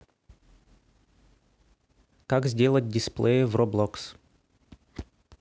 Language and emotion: Russian, neutral